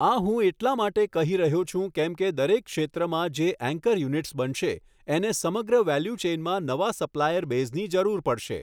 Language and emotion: Gujarati, neutral